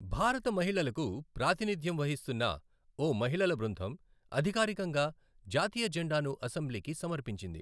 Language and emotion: Telugu, neutral